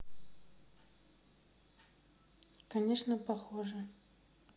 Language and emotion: Russian, neutral